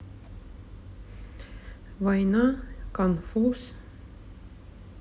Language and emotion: Russian, neutral